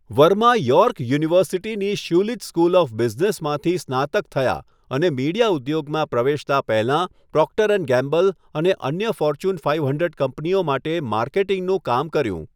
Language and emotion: Gujarati, neutral